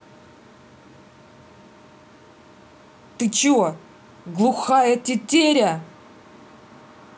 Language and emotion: Russian, angry